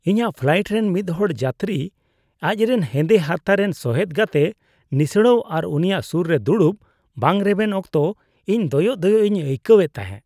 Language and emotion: Santali, disgusted